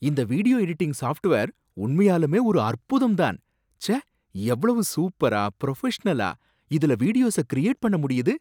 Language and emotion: Tamil, surprised